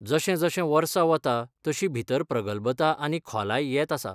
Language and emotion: Goan Konkani, neutral